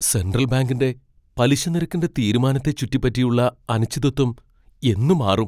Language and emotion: Malayalam, fearful